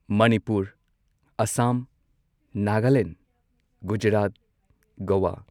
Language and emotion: Manipuri, neutral